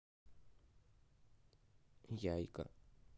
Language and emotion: Russian, neutral